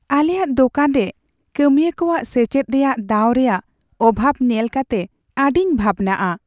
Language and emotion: Santali, sad